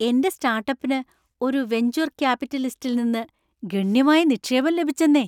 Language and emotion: Malayalam, happy